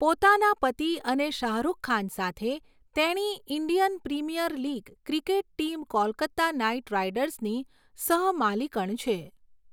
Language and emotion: Gujarati, neutral